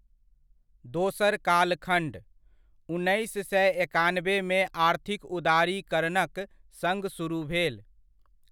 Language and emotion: Maithili, neutral